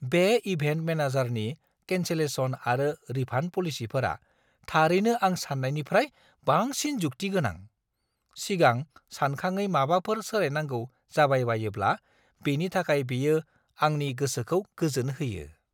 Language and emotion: Bodo, surprised